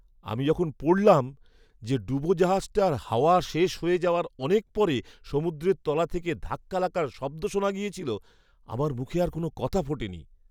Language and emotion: Bengali, surprised